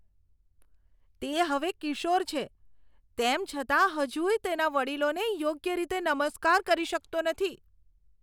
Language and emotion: Gujarati, disgusted